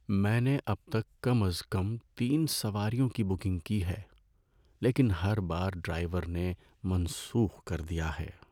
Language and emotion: Urdu, sad